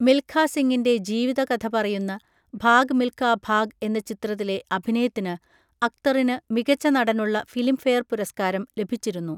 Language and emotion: Malayalam, neutral